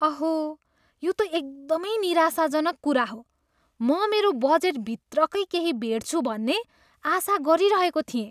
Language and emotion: Nepali, disgusted